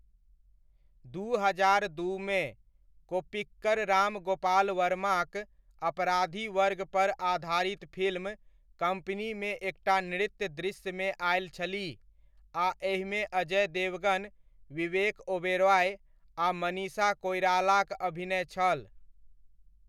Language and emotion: Maithili, neutral